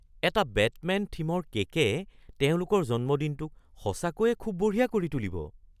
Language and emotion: Assamese, surprised